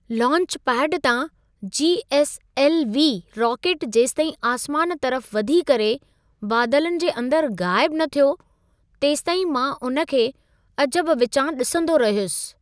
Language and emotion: Sindhi, surprised